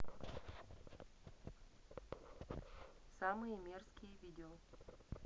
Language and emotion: Russian, neutral